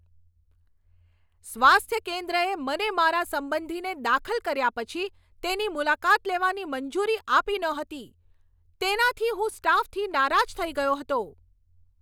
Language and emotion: Gujarati, angry